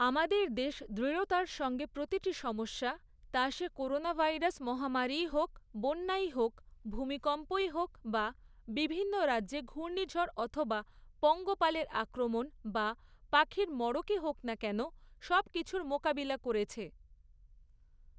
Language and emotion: Bengali, neutral